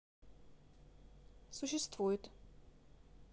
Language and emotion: Russian, neutral